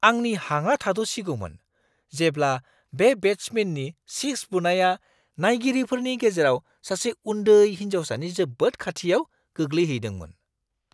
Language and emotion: Bodo, surprised